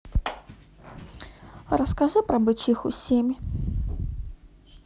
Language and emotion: Russian, neutral